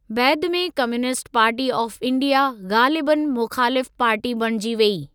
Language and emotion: Sindhi, neutral